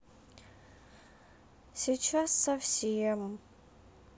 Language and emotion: Russian, sad